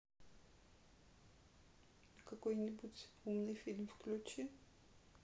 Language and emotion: Russian, sad